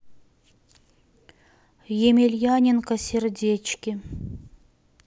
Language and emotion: Russian, neutral